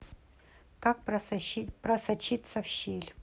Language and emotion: Russian, neutral